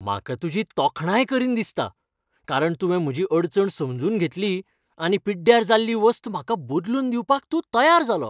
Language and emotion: Goan Konkani, happy